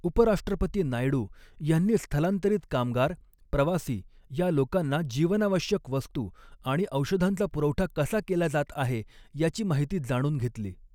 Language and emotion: Marathi, neutral